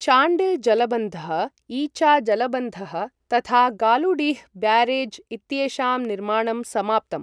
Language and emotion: Sanskrit, neutral